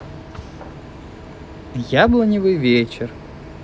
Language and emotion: Russian, neutral